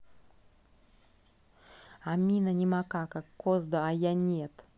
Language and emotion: Russian, angry